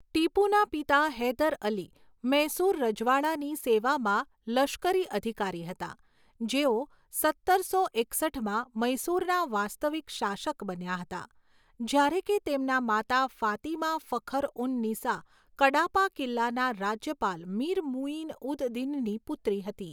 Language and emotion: Gujarati, neutral